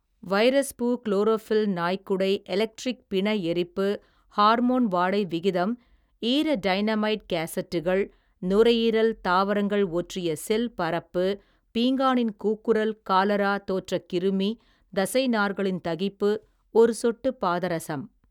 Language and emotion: Tamil, neutral